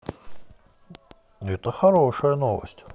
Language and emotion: Russian, positive